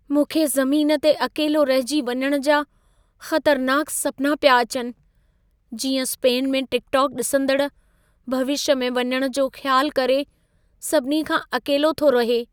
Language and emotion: Sindhi, fearful